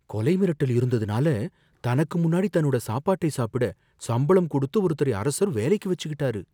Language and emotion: Tamil, fearful